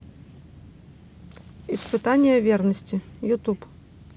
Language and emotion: Russian, neutral